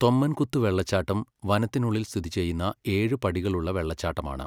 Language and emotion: Malayalam, neutral